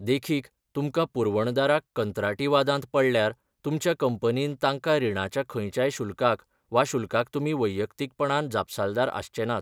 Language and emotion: Goan Konkani, neutral